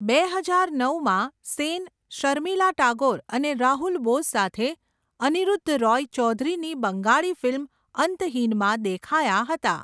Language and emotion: Gujarati, neutral